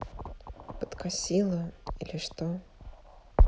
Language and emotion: Russian, sad